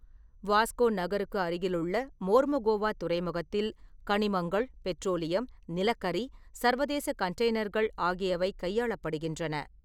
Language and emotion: Tamil, neutral